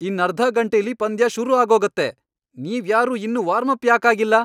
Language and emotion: Kannada, angry